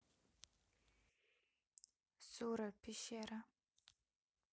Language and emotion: Russian, neutral